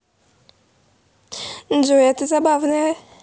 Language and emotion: Russian, positive